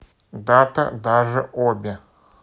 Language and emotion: Russian, neutral